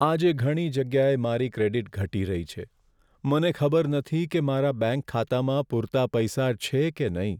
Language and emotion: Gujarati, sad